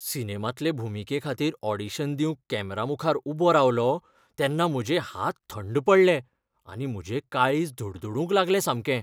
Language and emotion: Goan Konkani, fearful